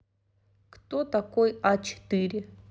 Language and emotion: Russian, neutral